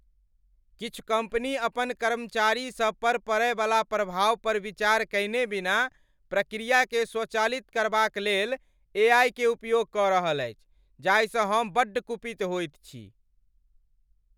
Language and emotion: Maithili, angry